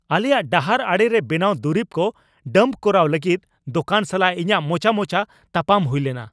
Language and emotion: Santali, angry